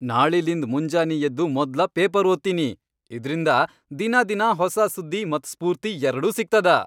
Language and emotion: Kannada, happy